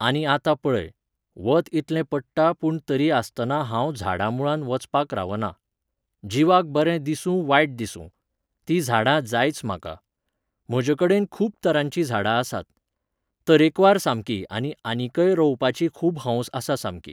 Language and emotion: Goan Konkani, neutral